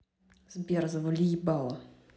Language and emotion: Russian, angry